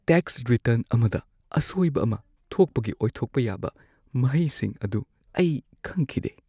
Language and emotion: Manipuri, fearful